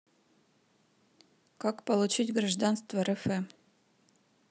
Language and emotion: Russian, neutral